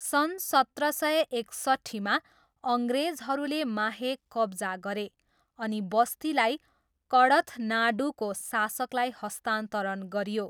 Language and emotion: Nepali, neutral